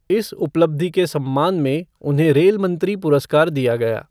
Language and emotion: Hindi, neutral